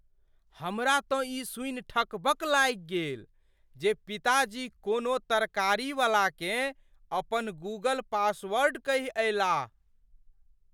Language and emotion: Maithili, surprised